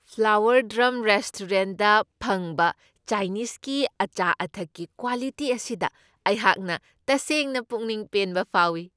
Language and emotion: Manipuri, happy